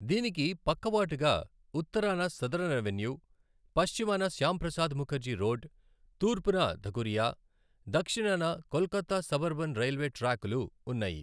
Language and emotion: Telugu, neutral